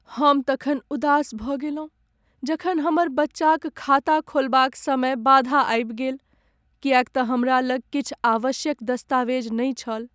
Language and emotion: Maithili, sad